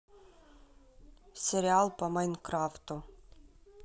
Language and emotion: Russian, neutral